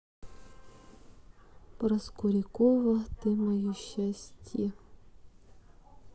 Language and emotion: Russian, sad